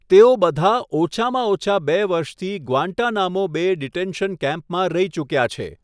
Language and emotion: Gujarati, neutral